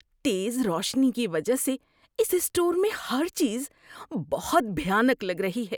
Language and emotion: Urdu, disgusted